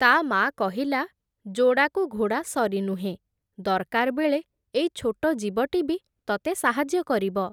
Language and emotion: Odia, neutral